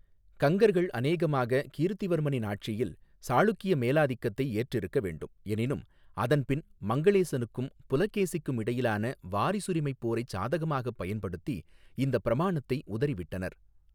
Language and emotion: Tamil, neutral